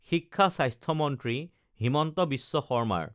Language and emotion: Assamese, neutral